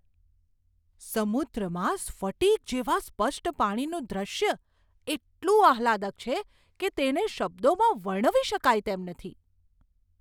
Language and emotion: Gujarati, surprised